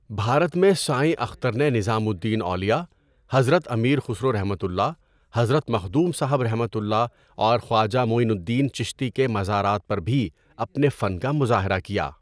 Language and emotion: Urdu, neutral